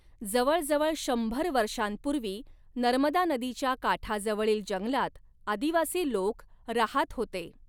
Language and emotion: Marathi, neutral